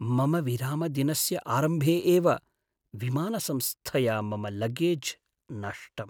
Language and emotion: Sanskrit, sad